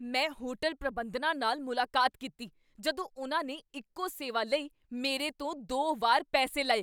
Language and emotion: Punjabi, angry